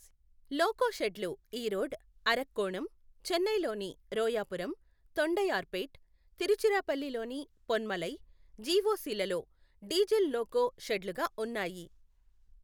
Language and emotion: Telugu, neutral